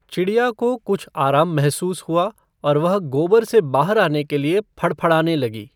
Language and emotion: Hindi, neutral